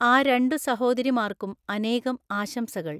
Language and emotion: Malayalam, neutral